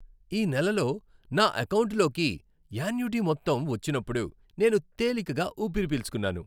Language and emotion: Telugu, happy